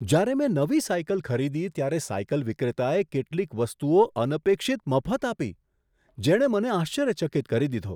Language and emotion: Gujarati, surprised